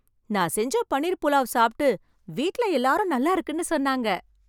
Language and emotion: Tamil, happy